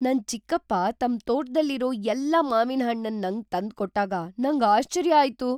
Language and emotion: Kannada, surprised